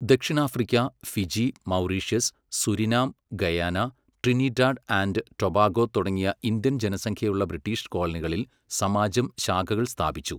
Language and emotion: Malayalam, neutral